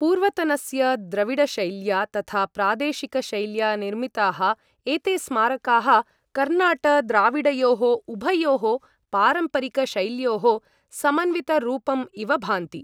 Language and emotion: Sanskrit, neutral